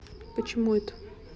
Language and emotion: Russian, neutral